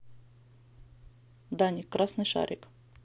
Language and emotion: Russian, neutral